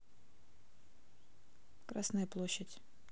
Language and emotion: Russian, neutral